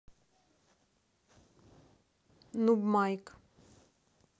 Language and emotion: Russian, neutral